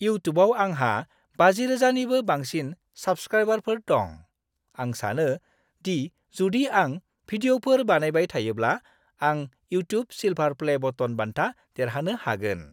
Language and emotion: Bodo, happy